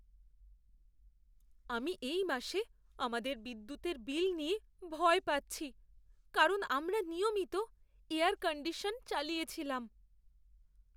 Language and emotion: Bengali, fearful